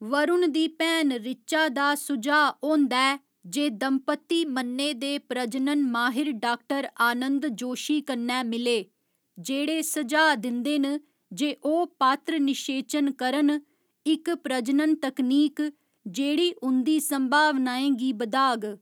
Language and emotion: Dogri, neutral